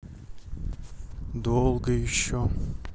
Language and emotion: Russian, sad